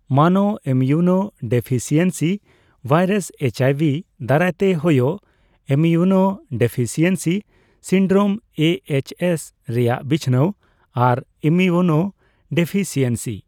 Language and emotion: Santali, neutral